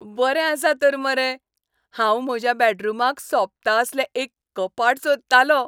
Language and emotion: Goan Konkani, happy